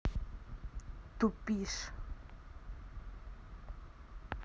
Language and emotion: Russian, angry